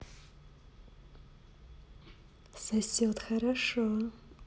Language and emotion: Russian, positive